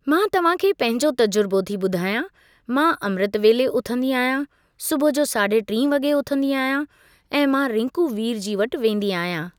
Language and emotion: Sindhi, neutral